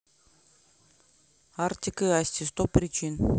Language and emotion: Russian, neutral